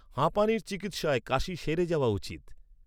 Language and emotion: Bengali, neutral